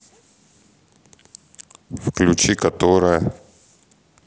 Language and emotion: Russian, neutral